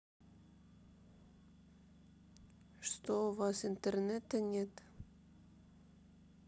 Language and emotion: Russian, sad